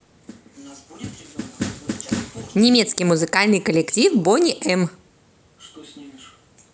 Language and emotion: Russian, positive